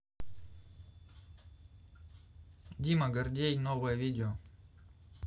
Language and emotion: Russian, neutral